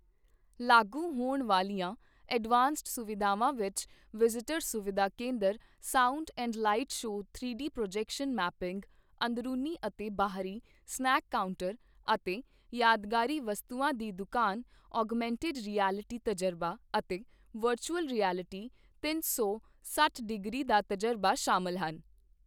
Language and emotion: Punjabi, neutral